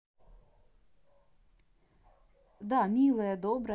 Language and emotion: Russian, neutral